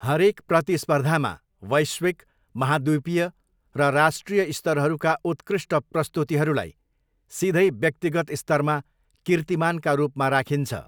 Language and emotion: Nepali, neutral